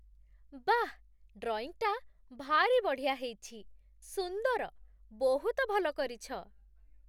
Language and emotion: Odia, surprised